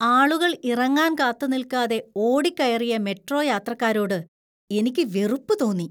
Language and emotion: Malayalam, disgusted